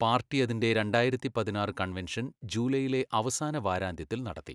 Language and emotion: Malayalam, neutral